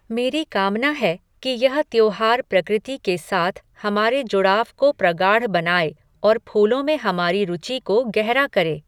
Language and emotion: Hindi, neutral